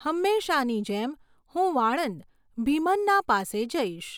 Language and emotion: Gujarati, neutral